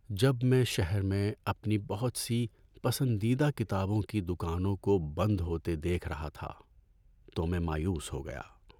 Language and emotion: Urdu, sad